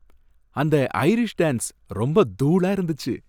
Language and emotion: Tamil, happy